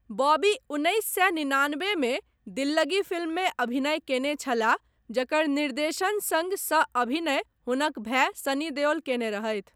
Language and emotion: Maithili, neutral